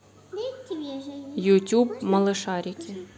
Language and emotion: Russian, neutral